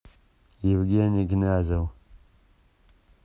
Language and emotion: Russian, neutral